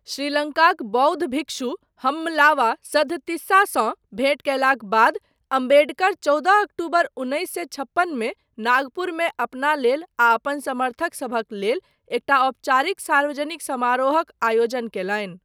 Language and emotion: Maithili, neutral